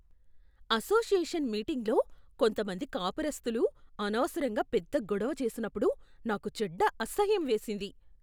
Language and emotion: Telugu, disgusted